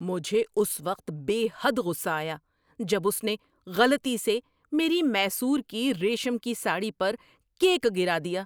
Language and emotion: Urdu, angry